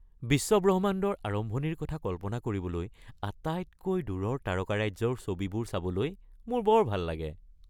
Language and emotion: Assamese, happy